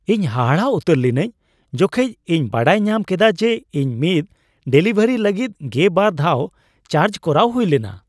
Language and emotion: Santali, surprised